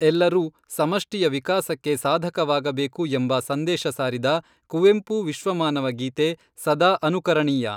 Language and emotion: Kannada, neutral